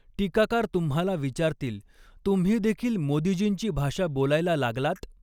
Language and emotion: Marathi, neutral